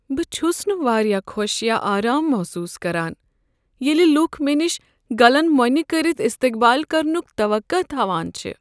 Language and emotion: Kashmiri, sad